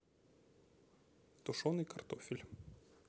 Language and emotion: Russian, neutral